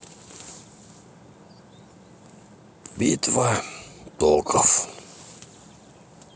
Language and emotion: Russian, sad